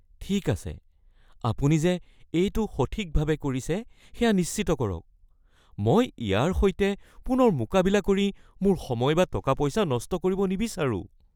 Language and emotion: Assamese, fearful